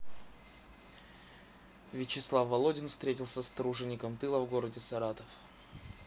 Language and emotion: Russian, neutral